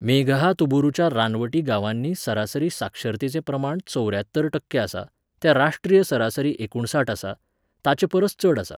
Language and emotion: Goan Konkani, neutral